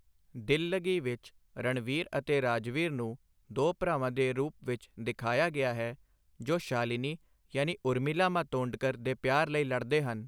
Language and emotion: Punjabi, neutral